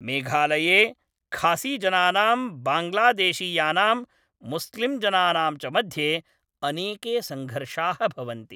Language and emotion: Sanskrit, neutral